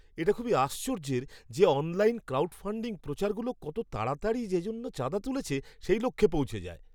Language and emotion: Bengali, surprised